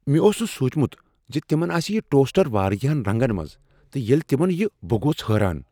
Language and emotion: Kashmiri, surprised